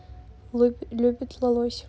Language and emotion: Russian, neutral